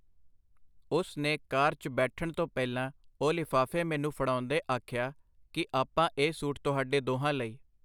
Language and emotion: Punjabi, neutral